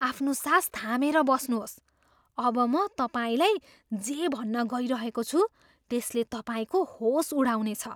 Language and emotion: Nepali, surprised